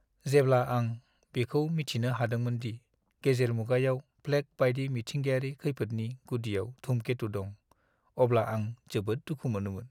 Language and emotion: Bodo, sad